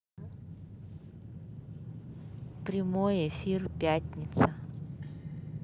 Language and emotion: Russian, neutral